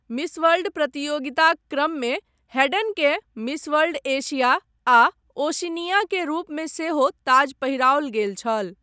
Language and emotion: Maithili, neutral